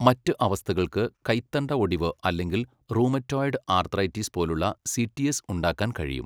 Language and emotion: Malayalam, neutral